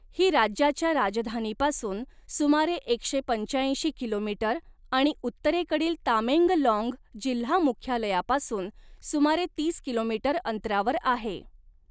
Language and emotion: Marathi, neutral